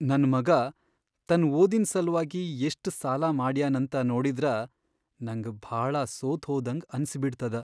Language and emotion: Kannada, sad